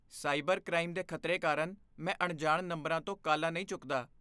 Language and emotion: Punjabi, fearful